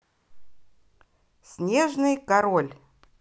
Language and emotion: Russian, positive